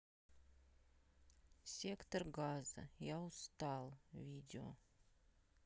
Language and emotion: Russian, sad